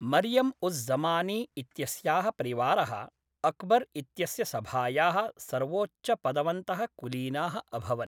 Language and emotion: Sanskrit, neutral